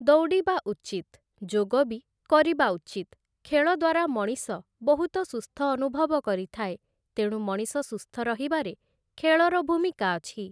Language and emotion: Odia, neutral